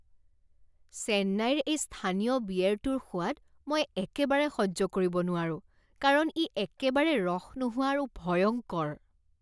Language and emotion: Assamese, disgusted